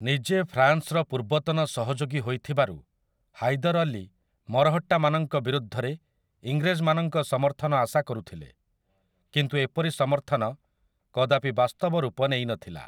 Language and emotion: Odia, neutral